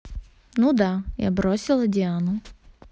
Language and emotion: Russian, neutral